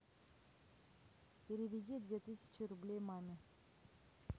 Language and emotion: Russian, neutral